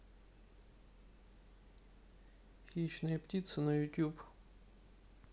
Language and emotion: Russian, neutral